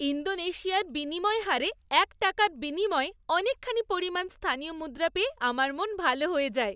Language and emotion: Bengali, happy